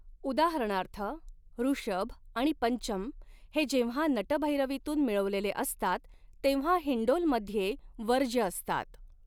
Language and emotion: Marathi, neutral